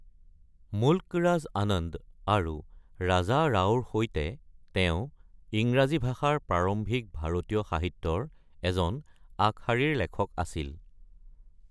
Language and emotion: Assamese, neutral